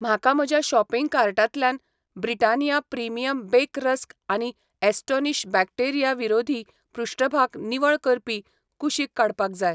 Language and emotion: Goan Konkani, neutral